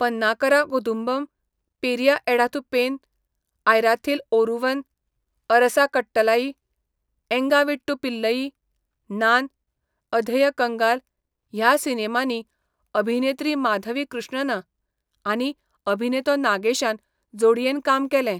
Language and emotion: Goan Konkani, neutral